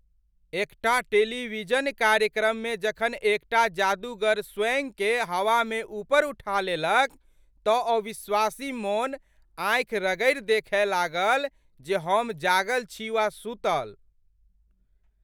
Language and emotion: Maithili, surprised